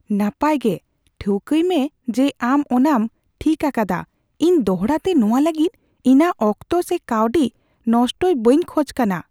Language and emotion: Santali, fearful